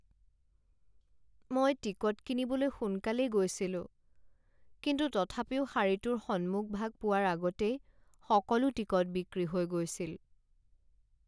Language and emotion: Assamese, sad